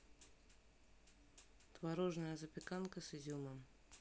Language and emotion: Russian, neutral